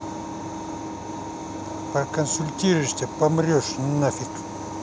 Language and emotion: Russian, angry